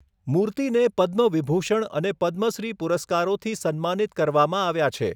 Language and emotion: Gujarati, neutral